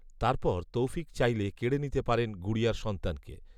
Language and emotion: Bengali, neutral